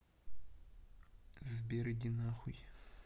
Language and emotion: Russian, neutral